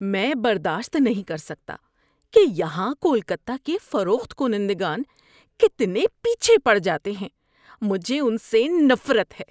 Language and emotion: Urdu, disgusted